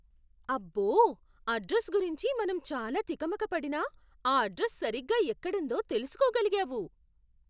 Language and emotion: Telugu, surprised